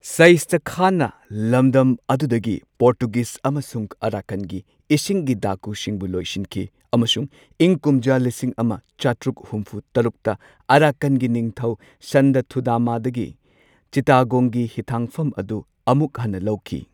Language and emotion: Manipuri, neutral